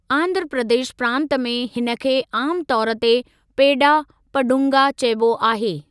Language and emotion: Sindhi, neutral